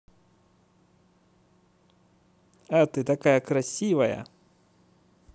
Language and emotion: Russian, positive